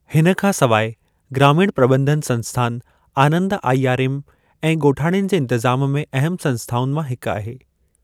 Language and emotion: Sindhi, neutral